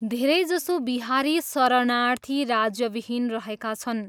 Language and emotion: Nepali, neutral